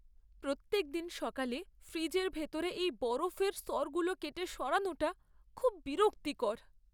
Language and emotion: Bengali, sad